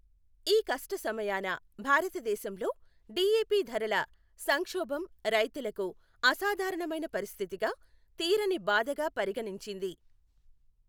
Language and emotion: Telugu, neutral